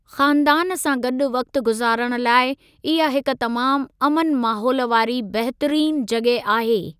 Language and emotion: Sindhi, neutral